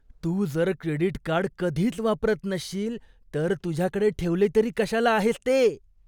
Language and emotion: Marathi, disgusted